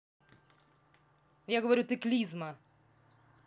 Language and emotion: Russian, angry